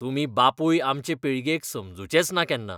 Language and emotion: Goan Konkani, disgusted